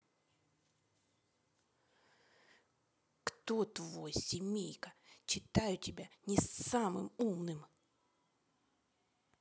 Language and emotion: Russian, angry